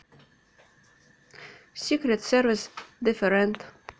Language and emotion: Russian, neutral